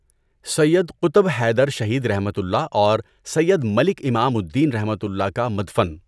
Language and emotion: Urdu, neutral